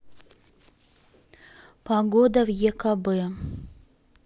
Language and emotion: Russian, neutral